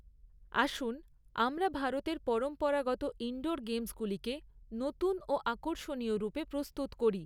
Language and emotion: Bengali, neutral